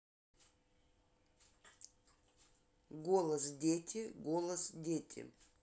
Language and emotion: Russian, neutral